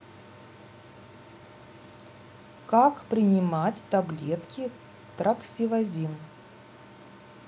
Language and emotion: Russian, neutral